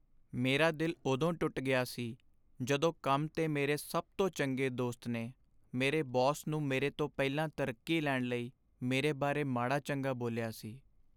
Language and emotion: Punjabi, sad